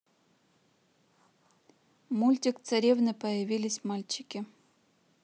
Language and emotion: Russian, neutral